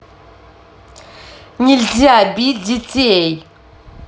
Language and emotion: Russian, angry